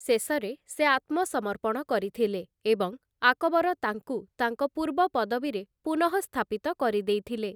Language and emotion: Odia, neutral